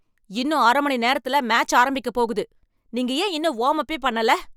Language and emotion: Tamil, angry